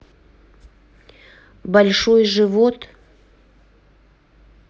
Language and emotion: Russian, neutral